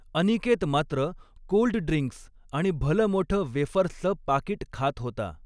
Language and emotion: Marathi, neutral